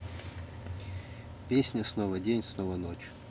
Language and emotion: Russian, neutral